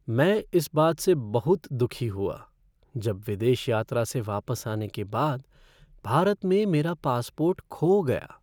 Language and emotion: Hindi, sad